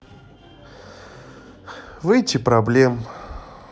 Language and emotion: Russian, sad